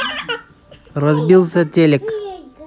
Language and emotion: Russian, neutral